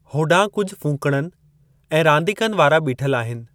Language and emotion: Sindhi, neutral